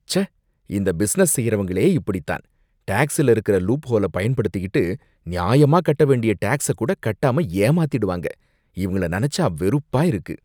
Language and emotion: Tamil, disgusted